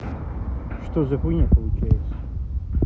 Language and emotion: Russian, neutral